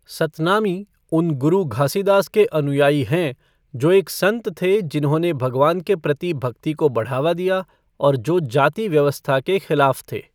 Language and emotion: Hindi, neutral